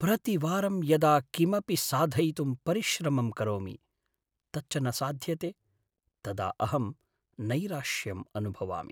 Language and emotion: Sanskrit, sad